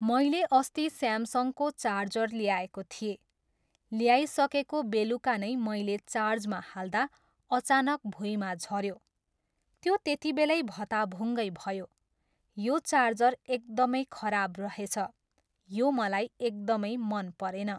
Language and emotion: Nepali, neutral